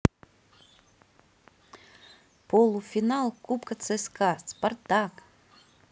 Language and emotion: Russian, positive